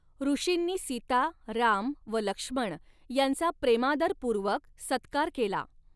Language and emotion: Marathi, neutral